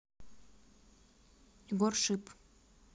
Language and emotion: Russian, neutral